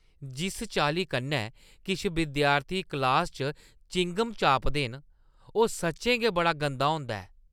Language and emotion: Dogri, disgusted